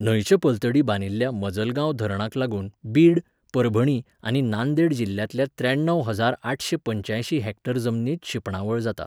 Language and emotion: Goan Konkani, neutral